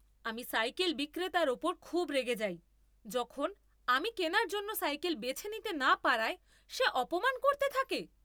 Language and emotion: Bengali, angry